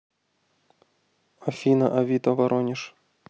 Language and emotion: Russian, neutral